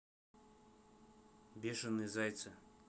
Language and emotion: Russian, neutral